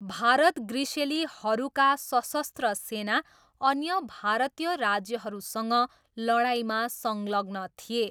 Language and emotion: Nepali, neutral